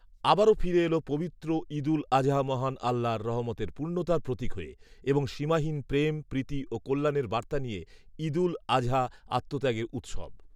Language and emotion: Bengali, neutral